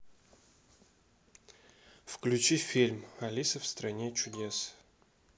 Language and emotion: Russian, neutral